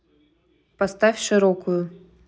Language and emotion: Russian, neutral